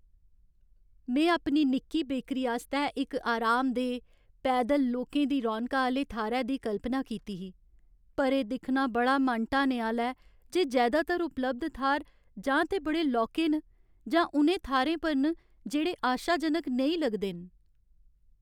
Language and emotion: Dogri, sad